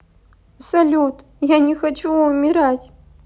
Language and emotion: Russian, sad